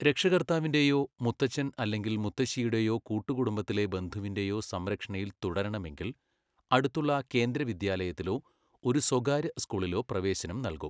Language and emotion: Malayalam, neutral